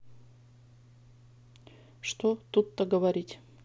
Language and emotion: Russian, neutral